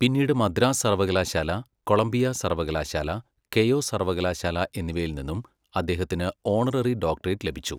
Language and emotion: Malayalam, neutral